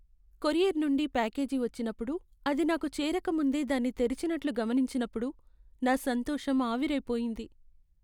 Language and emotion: Telugu, sad